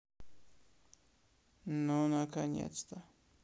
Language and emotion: Russian, neutral